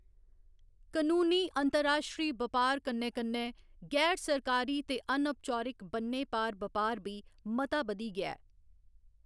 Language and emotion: Dogri, neutral